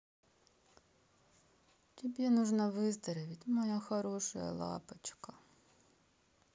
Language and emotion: Russian, sad